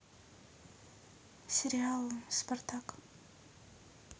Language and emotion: Russian, neutral